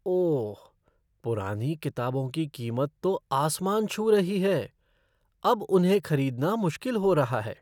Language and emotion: Hindi, surprised